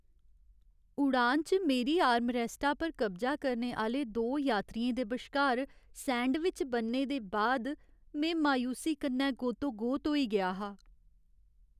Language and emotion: Dogri, sad